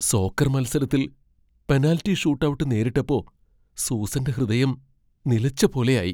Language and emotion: Malayalam, fearful